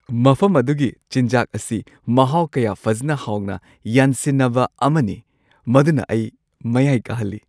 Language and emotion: Manipuri, happy